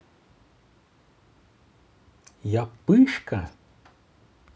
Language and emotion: Russian, positive